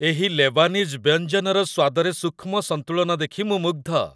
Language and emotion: Odia, happy